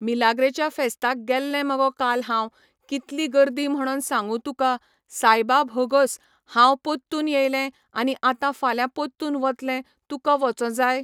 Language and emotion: Goan Konkani, neutral